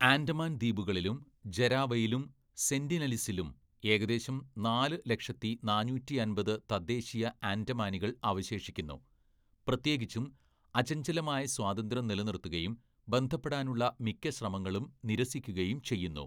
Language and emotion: Malayalam, neutral